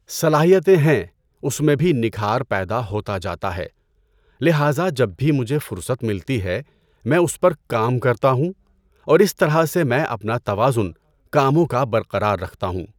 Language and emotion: Urdu, neutral